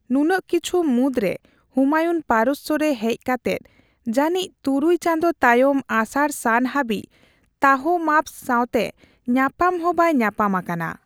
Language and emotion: Santali, neutral